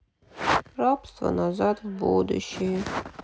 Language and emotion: Russian, sad